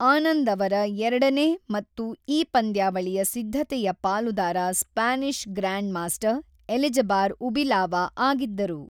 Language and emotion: Kannada, neutral